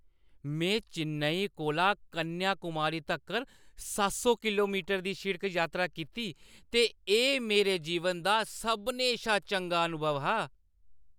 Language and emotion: Dogri, happy